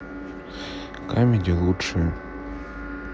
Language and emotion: Russian, neutral